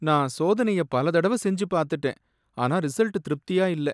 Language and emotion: Tamil, sad